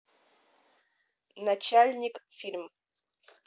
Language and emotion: Russian, neutral